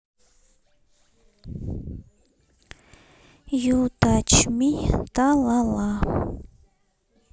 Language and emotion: Russian, sad